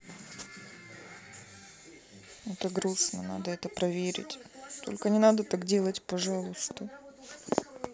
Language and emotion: Russian, sad